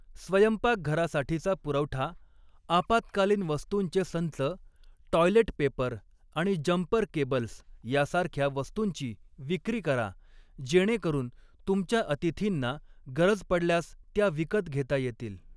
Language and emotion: Marathi, neutral